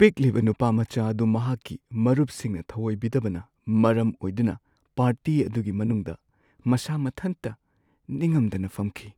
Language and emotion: Manipuri, sad